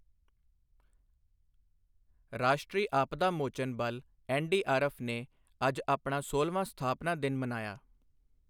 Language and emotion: Punjabi, neutral